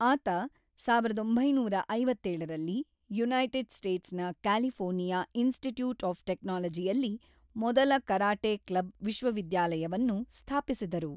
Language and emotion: Kannada, neutral